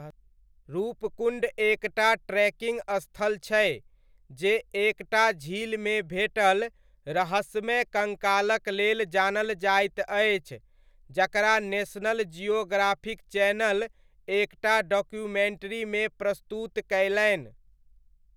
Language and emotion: Maithili, neutral